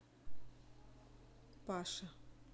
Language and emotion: Russian, neutral